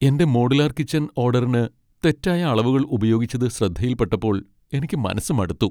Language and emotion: Malayalam, sad